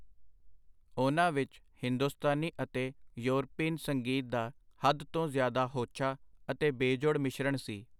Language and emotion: Punjabi, neutral